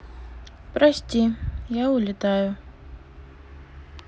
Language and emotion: Russian, sad